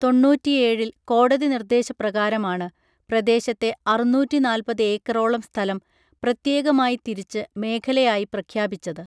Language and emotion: Malayalam, neutral